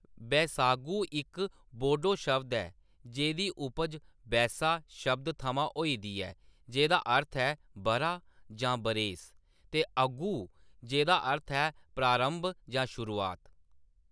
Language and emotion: Dogri, neutral